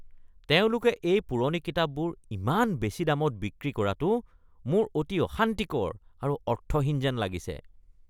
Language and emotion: Assamese, disgusted